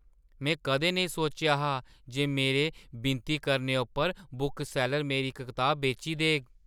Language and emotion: Dogri, surprised